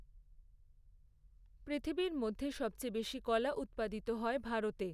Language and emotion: Bengali, neutral